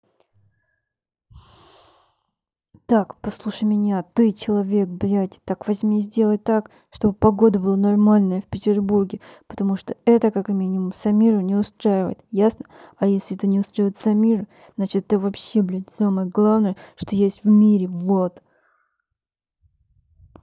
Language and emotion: Russian, angry